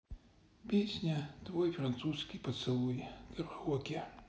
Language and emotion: Russian, sad